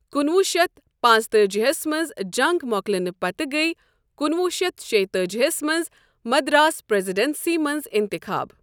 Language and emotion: Kashmiri, neutral